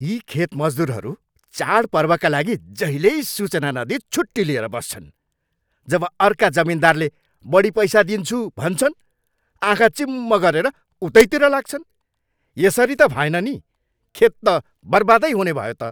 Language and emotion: Nepali, angry